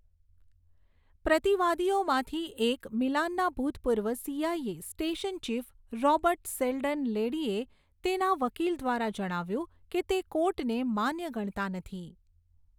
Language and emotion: Gujarati, neutral